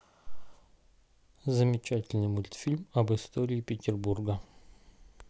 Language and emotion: Russian, neutral